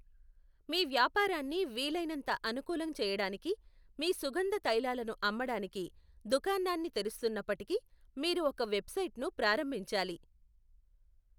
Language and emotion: Telugu, neutral